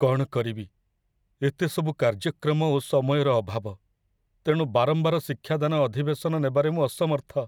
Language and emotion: Odia, sad